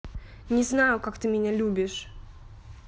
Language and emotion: Russian, angry